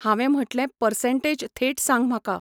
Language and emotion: Goan Konkani, neutral